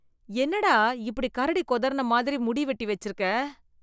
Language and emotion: Tamil, disgusted